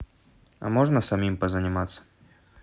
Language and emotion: Russian, neutral